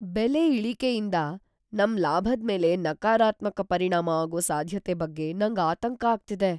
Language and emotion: Kannada, fearful